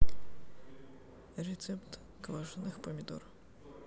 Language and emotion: Russian, neutral